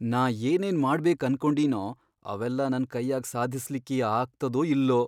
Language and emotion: Kannada, fearful